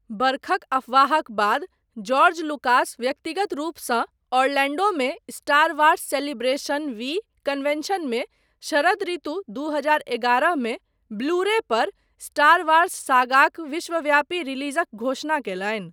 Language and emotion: Maithili, neutral